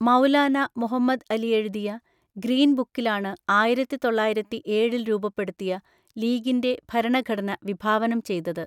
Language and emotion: Malayalam, neutral